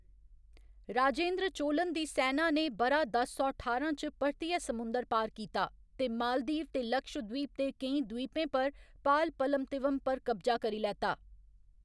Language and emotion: Dogri, neutral